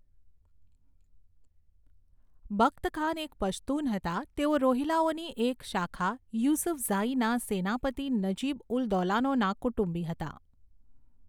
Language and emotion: Gujarati, neutral